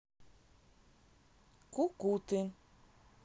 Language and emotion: Russian, neutral